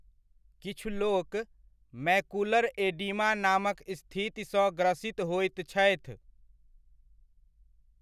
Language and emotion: Maithili, neutral